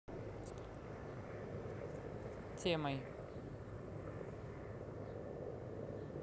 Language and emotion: Russian, neutral